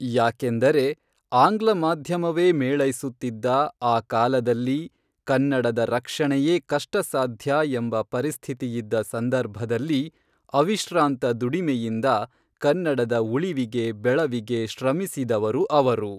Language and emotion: Kannada, neutral